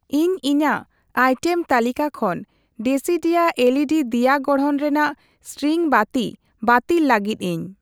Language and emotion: Santali, neutral